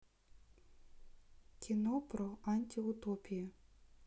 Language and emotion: Russian, neutral